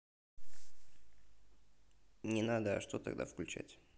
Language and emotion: Russian, neutral